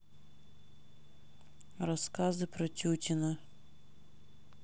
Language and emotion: Russian, neutral